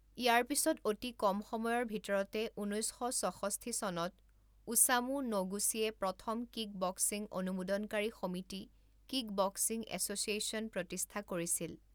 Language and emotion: Assamese, neutral